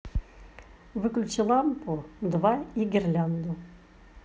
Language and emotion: Russian, neutral